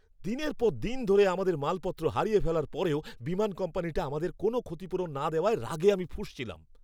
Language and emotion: Bengali, angry